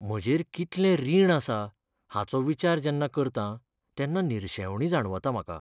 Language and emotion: Goan Konkani, sad